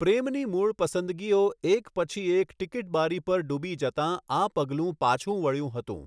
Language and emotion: Gujarati, neutral